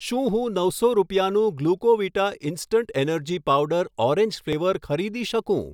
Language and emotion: Gujarati, neutral